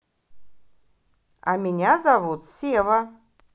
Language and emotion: Russian, positive